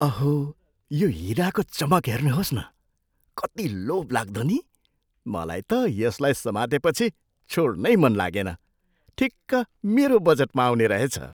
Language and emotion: Nepali, surprised